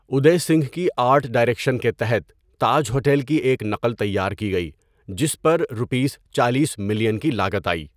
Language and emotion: Urdu, neutral